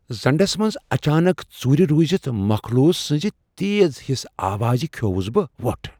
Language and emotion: Kashmiri, fearful